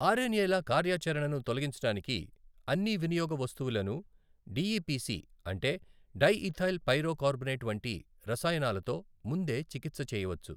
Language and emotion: Telugu, neutral